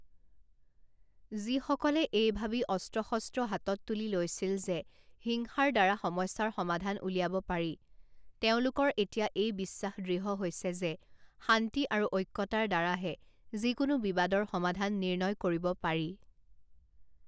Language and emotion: Assamese, neutral